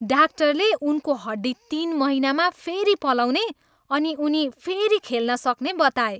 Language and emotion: Nepali, happy